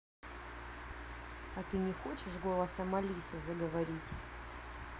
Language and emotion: Russian, neutral